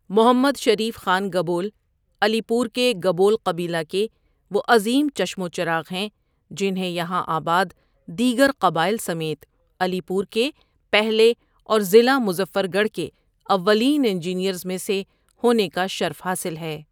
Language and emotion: Urdu, neutral